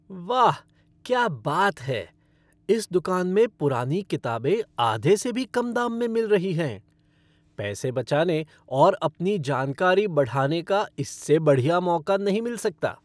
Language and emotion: Hindi, happy